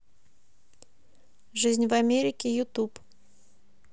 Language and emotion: Russian, neutral